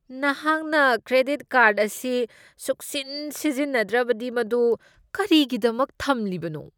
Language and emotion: Manipuri, disgusted